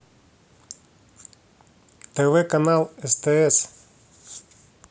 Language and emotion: Russian, neutral